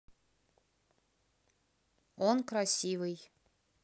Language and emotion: Russian, neutral